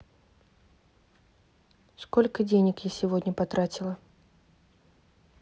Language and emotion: Russian, neutral